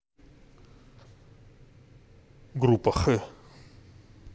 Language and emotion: Russian, neutral